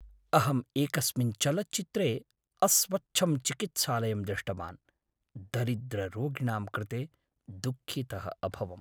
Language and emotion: Sanskrit, sad